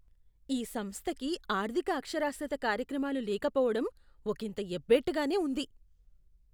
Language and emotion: Telugu, disgusted